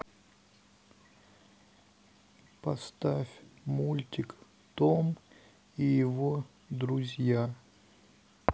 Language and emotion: Russian, sad